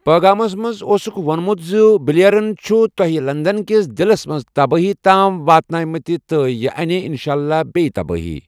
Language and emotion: Kashmiri, neutral